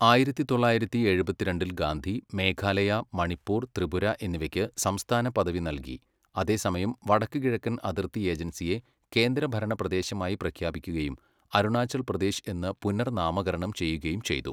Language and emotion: Malayalam, neutral